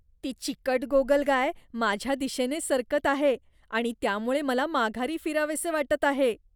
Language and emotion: Marathi, disgusted